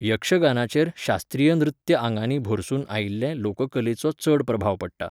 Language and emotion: Goan Konkani, neutral